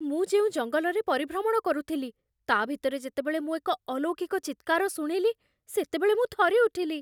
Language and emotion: Odia, fearful